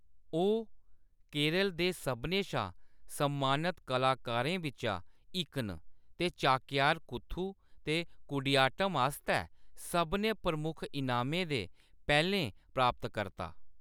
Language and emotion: Dogri, neutral